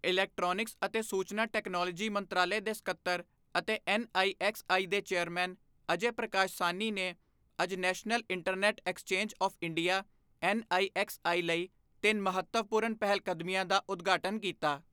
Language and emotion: Punjabi, neutral